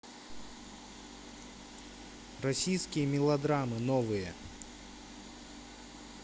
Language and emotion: Russian, neutral